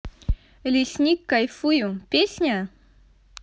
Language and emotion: Russian, positive